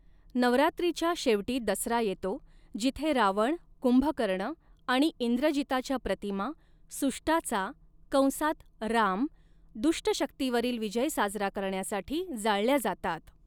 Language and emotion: Marathi, neutral